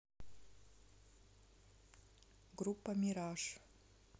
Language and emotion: Russian, neutral